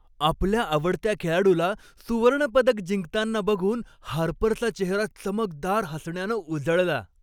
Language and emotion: Marathi, happy